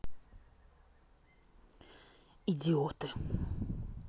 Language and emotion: Russian, angry